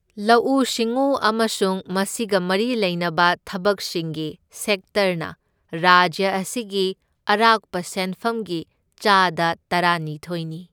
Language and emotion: Manipuri, neutral